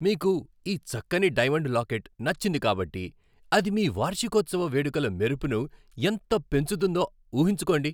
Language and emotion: Telugu, happy